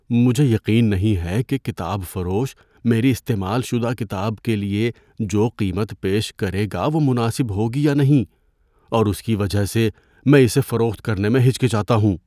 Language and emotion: Urdu, fearful